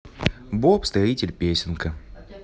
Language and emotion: Russian, positive